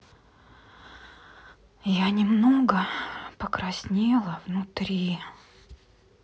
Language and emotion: Russian, sad